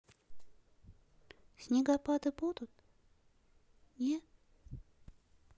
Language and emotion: Russian, sad